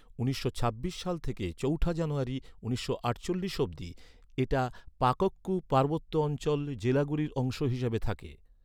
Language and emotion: Bengali, neutral